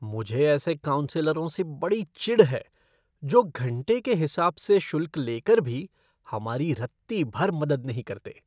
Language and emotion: Hindi, disgusted